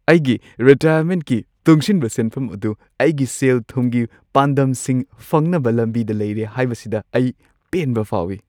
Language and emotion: Manipuri, happy